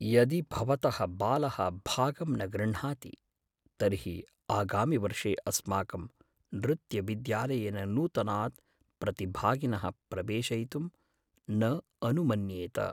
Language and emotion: Sanskrit, fearful